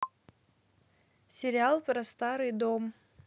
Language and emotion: Russian, neutral